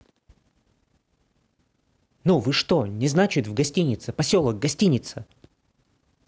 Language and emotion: Russian, neutral